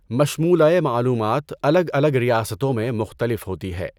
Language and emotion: Urdu, neutral